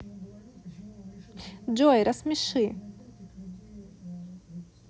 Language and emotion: Russian, neutral